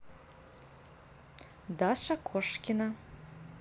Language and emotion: Russian, neutral